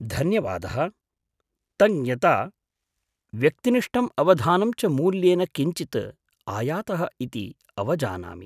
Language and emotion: Sanskrit, surprised